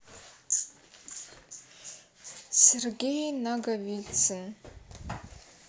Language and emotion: Russian, neutral